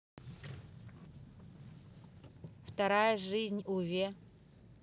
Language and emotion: Russian, neutral